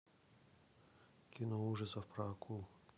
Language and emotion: Russian, neutral